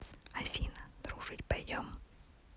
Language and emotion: Russian, neutral